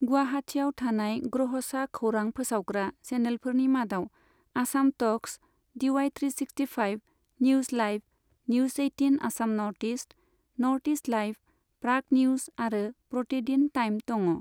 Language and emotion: Bodo, neutral